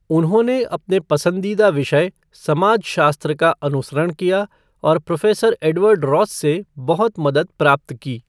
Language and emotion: Hindi, neutral